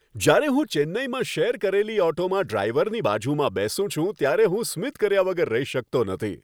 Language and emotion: Gujarati, happy